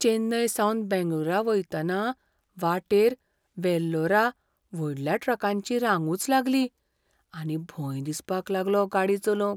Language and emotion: Goan Konkani, fearful